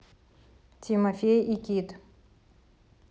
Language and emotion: Russian, neutral